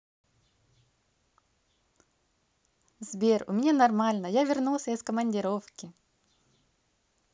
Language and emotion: Russian, positive